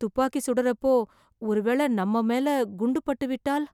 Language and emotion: Tamil, fearful